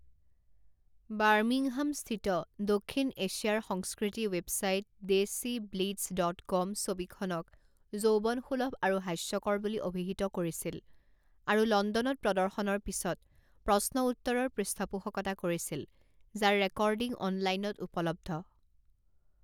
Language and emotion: Assamese, neutral